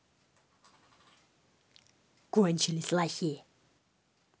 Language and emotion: Russian, angry